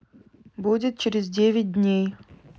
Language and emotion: Russian, neutral